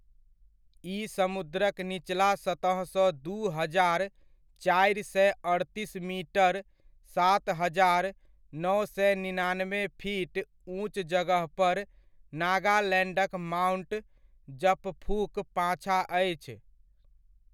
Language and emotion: Maithili, neutral